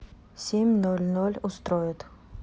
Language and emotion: Russian, neutral